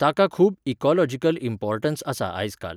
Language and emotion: Goan Konkani, neutral